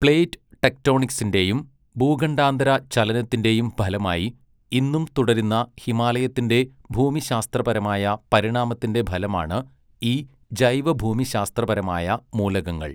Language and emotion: Malayalam, neutral